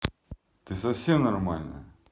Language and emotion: Russian, angry